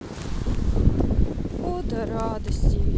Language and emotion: Russian, sad